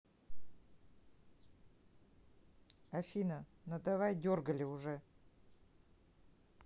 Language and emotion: Russian, neutral